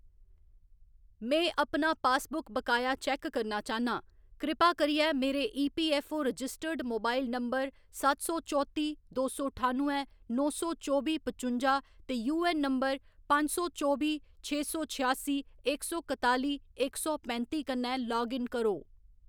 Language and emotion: Dogri, neutral